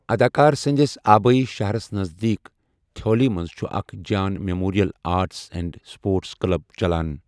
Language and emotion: Kashmiri, neutral